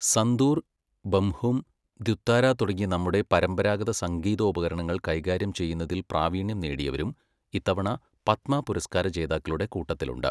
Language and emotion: Malayalam, neutral